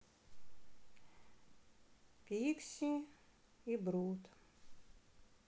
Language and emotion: Russian, sad